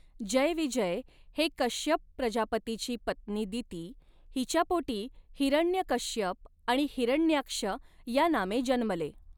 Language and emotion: Marathi, neutral